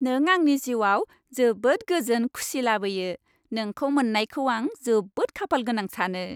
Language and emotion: Bodo, happy